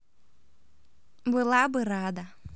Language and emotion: Russian, positive